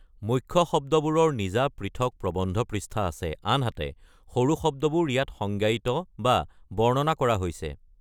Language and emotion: Assamese, neutral